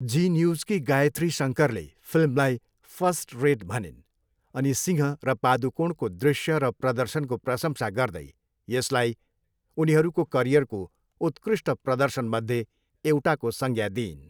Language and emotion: Nepali, neutral